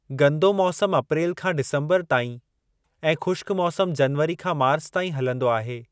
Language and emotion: Sindhi, neutral